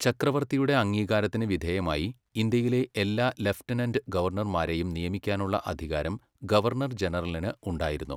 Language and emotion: Malayalam, neutral